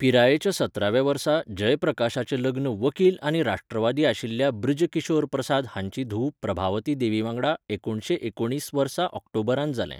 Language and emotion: Goan Konkani, neutral